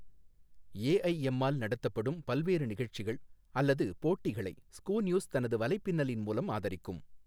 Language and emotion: Tamil, neutral